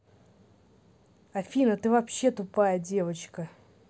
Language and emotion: Russian, angry